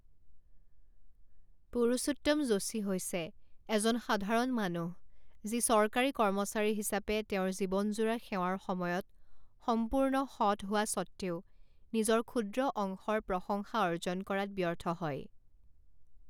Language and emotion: Assamese, neutral